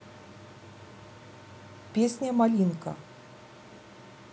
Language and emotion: Russian, neutral